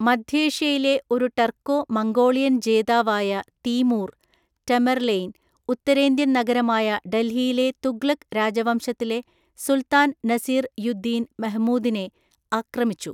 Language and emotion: Malayalam, neutral